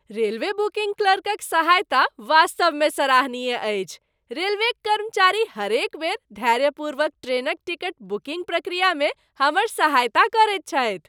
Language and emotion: Maithili, happy